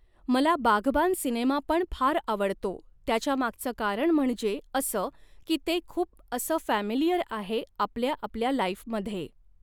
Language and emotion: Marathi, neutral